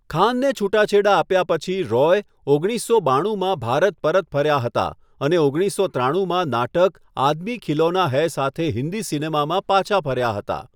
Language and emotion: Gujarati, neutral